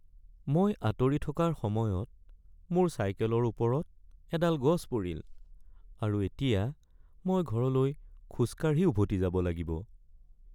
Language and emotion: Assamese, sad